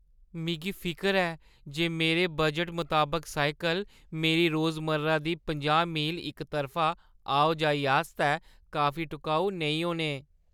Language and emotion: Dogri, fearful